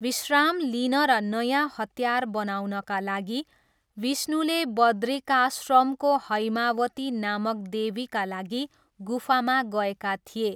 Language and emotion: Nepali, neutral